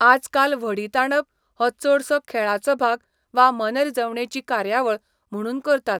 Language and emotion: Goan Konkani, neutral